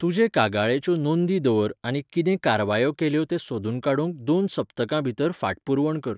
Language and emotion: Goan Konkani, neutral